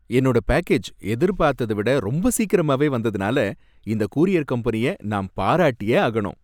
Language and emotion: Tamil, happy